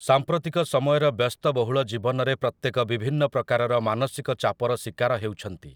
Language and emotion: Odia, neutral